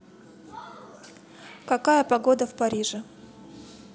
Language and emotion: Russian, neutral